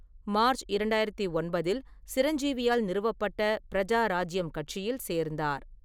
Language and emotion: Tamil, neutral